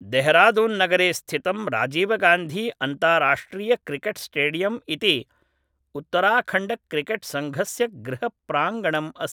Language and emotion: Sanskrit, neutral